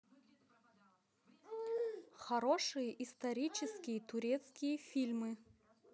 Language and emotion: Russian, neutral